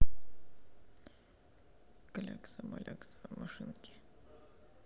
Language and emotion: Russian, sad